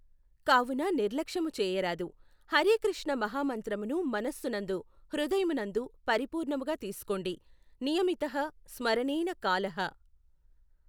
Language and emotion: Telugu, neutral